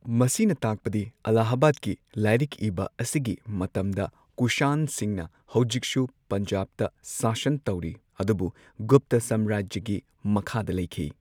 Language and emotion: Manipuri, neutral